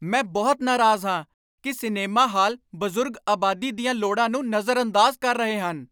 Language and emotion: Punjabi, angry